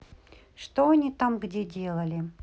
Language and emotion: Russian, neutral